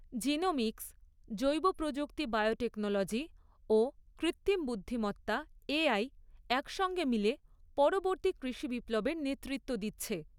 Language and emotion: Bengali, neutral